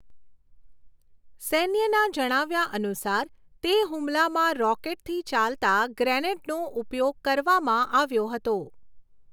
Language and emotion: Gujarati, neutral